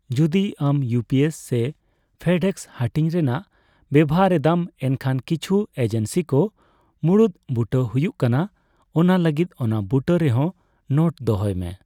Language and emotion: Santali, neutral